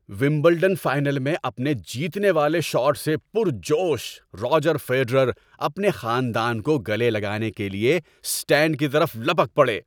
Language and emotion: Urdu, happy